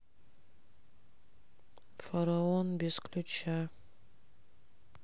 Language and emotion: Russian, sad